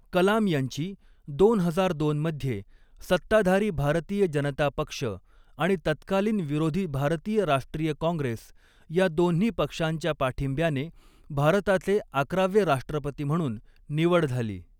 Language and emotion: Marathi, neutral